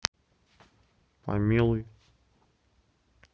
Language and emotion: Russian, neutral